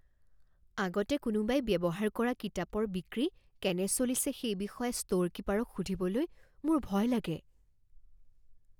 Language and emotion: Assamese, fearful